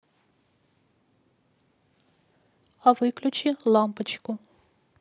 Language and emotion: Russian, neutral